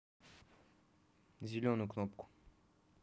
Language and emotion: Russian, neutral